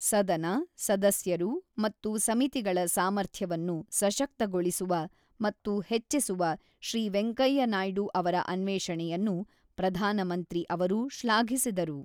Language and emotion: Kannada, neutral